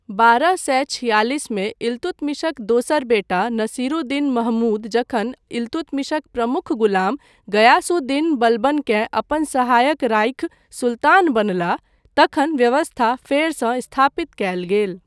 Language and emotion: Maithili, neutral